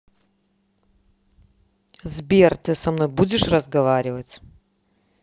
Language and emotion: Russian, angry